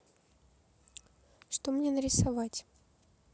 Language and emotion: Russian, neutral